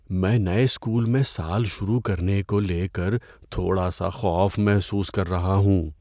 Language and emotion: Urdu, fearful